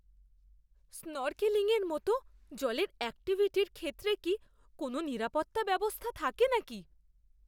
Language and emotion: Bengali, fearful